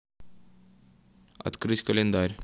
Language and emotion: Russian, neutral